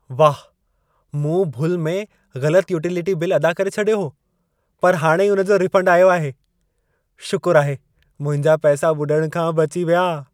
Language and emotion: Sindhi, happy